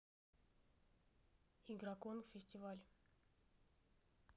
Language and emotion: Russian, neutral